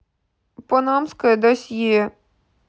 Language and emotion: Russian, sad